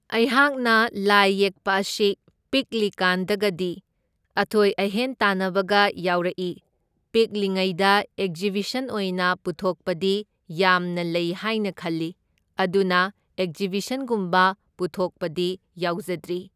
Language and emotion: Manipuri, neutral